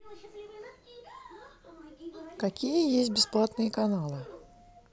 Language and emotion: Russian, neutral